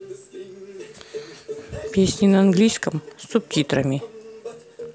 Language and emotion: Russian, neutral